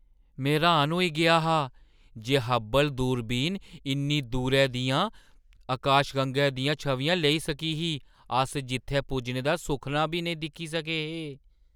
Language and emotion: Dogri, surprised